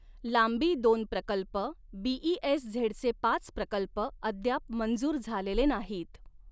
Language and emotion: Marathi, neutral